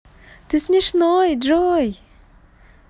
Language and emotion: Russian, positive